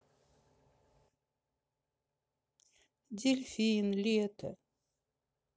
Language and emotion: Russian, sad